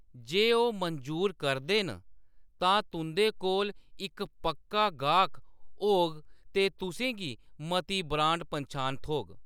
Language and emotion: Dogri, neutral